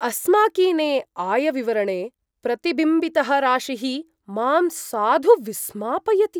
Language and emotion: Sanskrit, surprised